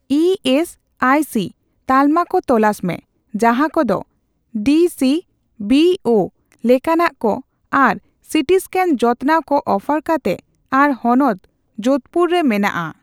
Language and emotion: Santali, neutral